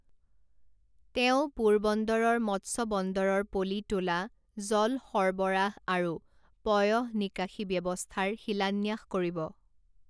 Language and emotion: Assamese, neutral